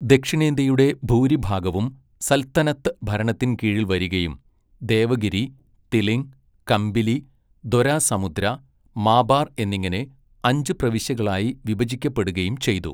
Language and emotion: Malayalam, neutral